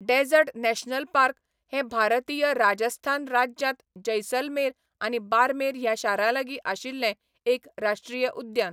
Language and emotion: Goan Konkani, neutral